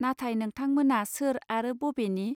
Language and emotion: Bodo, neutral